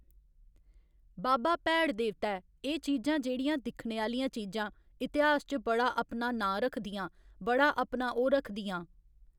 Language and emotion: Dogri, neutral